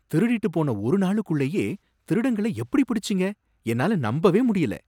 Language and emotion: Tamil, surprised